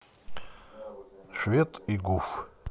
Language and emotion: Russian, neutral